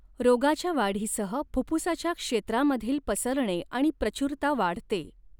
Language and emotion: Marathi, neutral